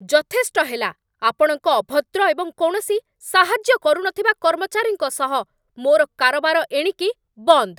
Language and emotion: Odia, angry